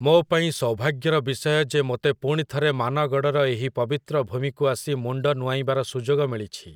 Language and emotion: Odia, neutral